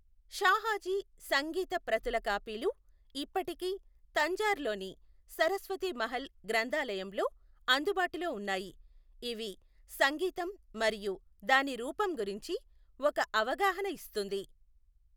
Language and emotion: Telugu, neutral